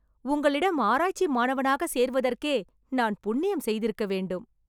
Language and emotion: Tamil, happy